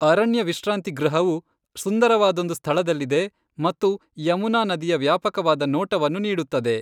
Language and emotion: Kannada, neutral